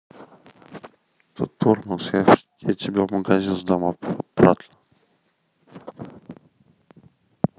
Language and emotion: Russian, neutral